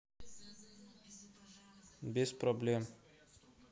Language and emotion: Russian, neutral